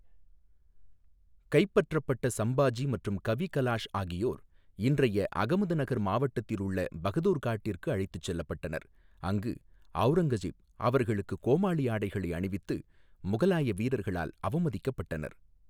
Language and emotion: Tamil, neutral